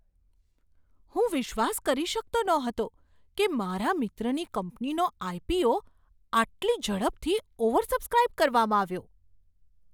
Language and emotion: Gujarati, surprised